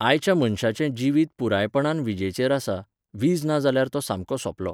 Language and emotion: Goan Konkani, neutral